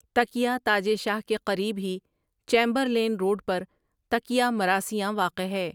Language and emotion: Urdu, neutral